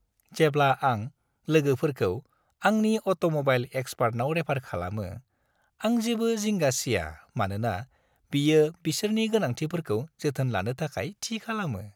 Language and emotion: Bodo, happy